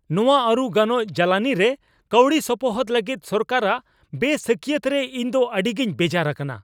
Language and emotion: Santali, angry